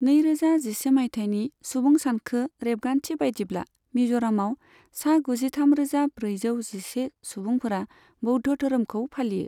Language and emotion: Bodo, neutral